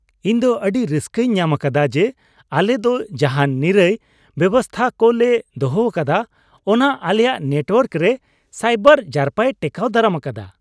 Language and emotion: Santali, happy